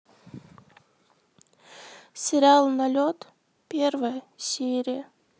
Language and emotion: Russian, sad